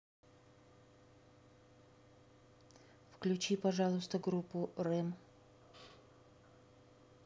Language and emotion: Russian, neutral